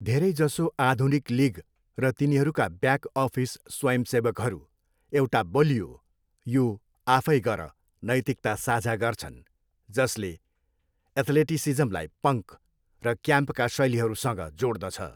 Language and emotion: Nepali, neutral